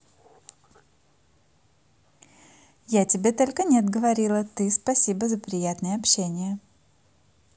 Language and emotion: Russian, positive